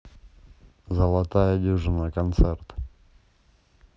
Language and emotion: Russian, neutral